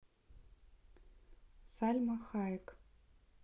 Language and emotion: Russian, neutral